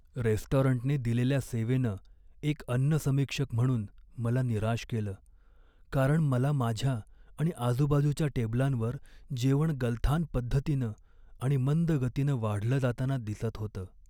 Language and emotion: Marathi, sad